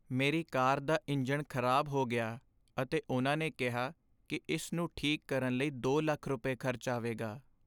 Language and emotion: Punjabi, sad